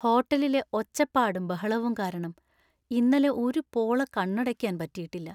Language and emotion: Malayalam, sad